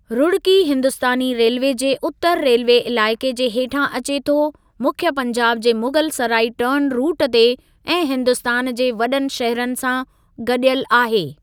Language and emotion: Sindhi, neutral